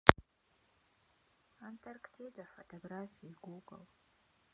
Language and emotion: Russian, sad